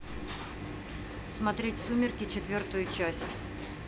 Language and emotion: Russian, neutral